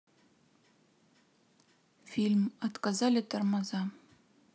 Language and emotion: Russian, neutral